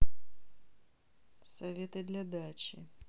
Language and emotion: Russian, neutral